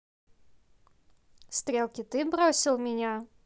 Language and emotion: Russian, neutral